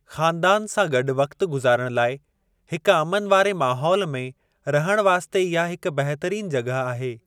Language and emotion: Sindhi, neutral